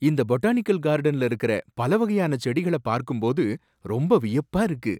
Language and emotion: Tamil, surprised